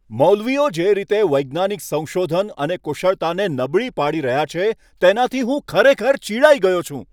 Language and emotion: Gujarati, angry